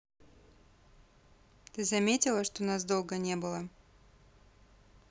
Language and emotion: Russian, neutral